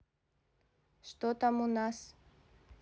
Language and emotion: Russian, neutral